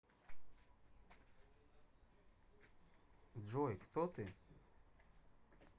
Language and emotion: Russian, neutral